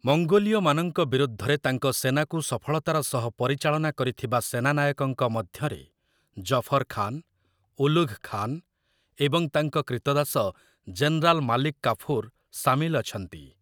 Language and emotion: Odia, neutral